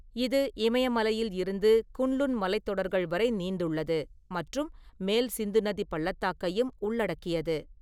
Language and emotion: Tamil, neutral